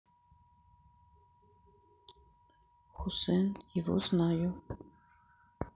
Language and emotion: Russian, sad